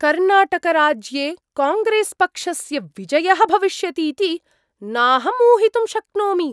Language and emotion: Sanskrit, surprised